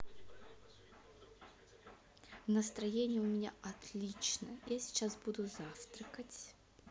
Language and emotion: Russian, positive